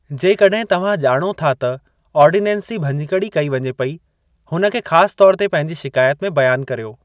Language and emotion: Sindhi, neutral